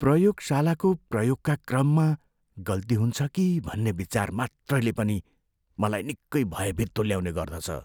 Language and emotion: Nepali, fearful